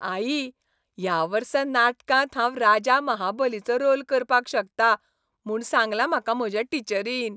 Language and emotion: Goan Konkani, happy